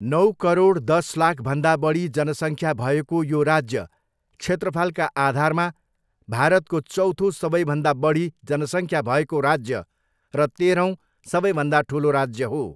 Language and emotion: Nepali, neutral